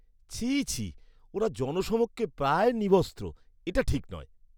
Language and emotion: Bengali, disgusted